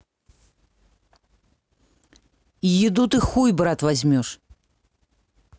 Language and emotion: Russian, angry